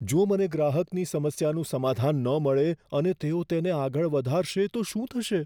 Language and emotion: Gujarati, fearful